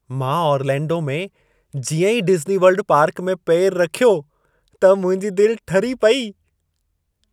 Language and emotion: Sindhi, happy